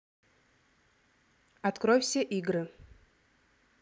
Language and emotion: Russian, neutral